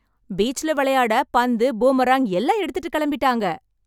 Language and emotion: Tamil, happy